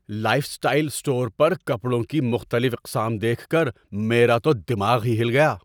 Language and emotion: Urdu, surprised